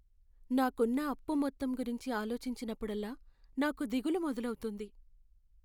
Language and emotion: Telugu, sad